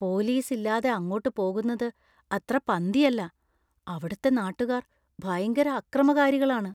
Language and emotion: Malayalam, fearful